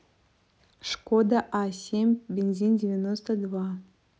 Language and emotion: Russian, neutral